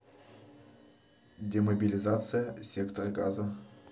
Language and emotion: Russian, neutral